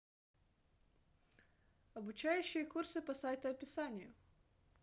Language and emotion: Russian, neutral